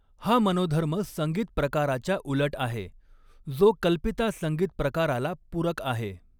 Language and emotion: Marathi, neutral